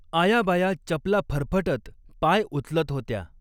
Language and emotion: Marathi, neutral